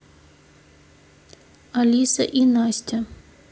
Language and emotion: Russian, neutral